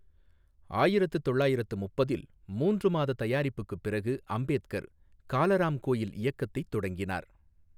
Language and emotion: Tamil, neutral